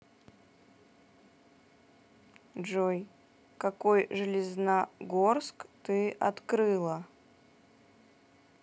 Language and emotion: Russian, neutral